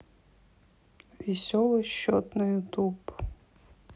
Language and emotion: Russian, neutral